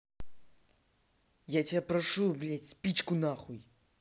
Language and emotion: Russian, angry